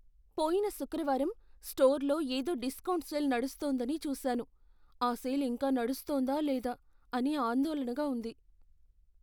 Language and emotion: Telugu, fearful